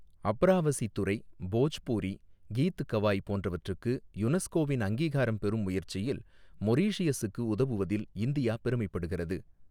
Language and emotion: Tamil, neutral